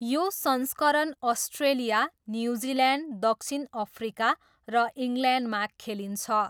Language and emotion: Nepali, neutral